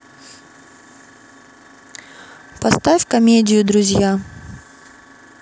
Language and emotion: Russian, neutral